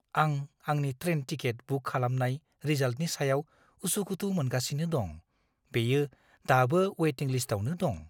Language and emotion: Bodo, fearful